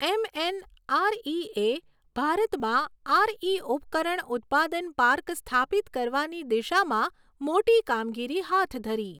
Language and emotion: Gujarati, neutral